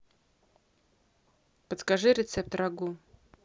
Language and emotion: Russian, neutral